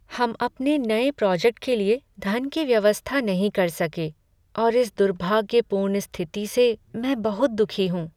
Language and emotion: Hindi, sad